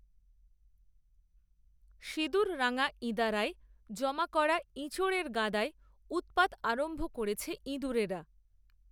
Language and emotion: Bengali, neutral